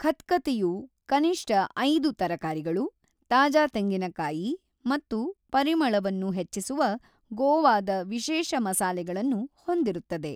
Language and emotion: Kannada, neutral